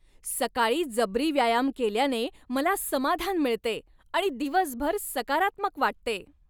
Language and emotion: Marathi, happy